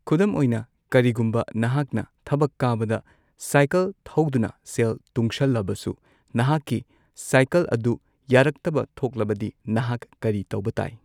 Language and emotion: Manipuri, neutral